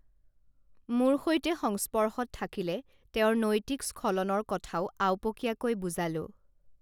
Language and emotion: Assamese, neutral